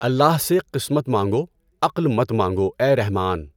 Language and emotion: Urdu, neutral